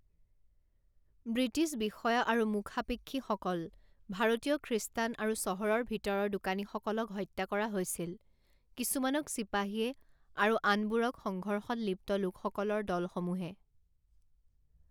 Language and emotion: Assamese, neutral